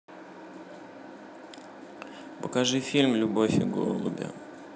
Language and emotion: Russian, neutral